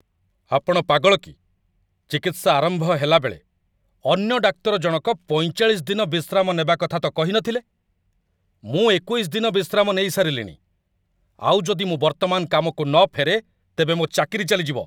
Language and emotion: Odia, angry